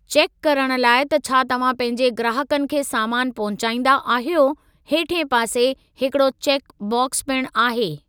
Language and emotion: Sindhi, neutral